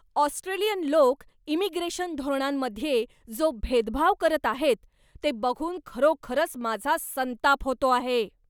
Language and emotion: Marathi, angry